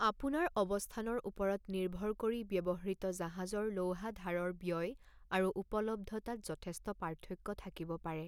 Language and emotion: Assamese, neutral